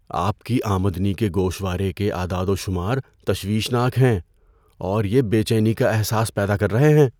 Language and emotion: Urdu, fearful